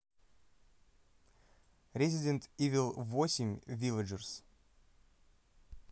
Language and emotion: Russian, neutral